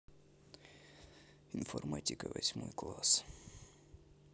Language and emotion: Russian, neutral